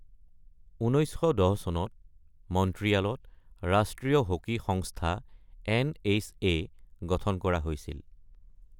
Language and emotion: Assamese, neutral